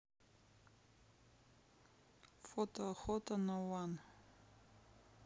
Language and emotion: Russian, neutral